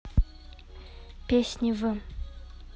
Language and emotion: Russian, neutral